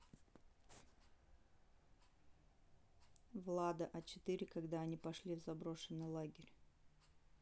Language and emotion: Russian, neutral